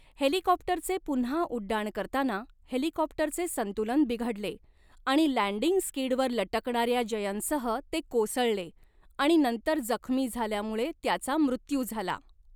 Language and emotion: Marathi, neutral